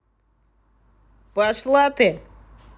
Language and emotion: Russian, angry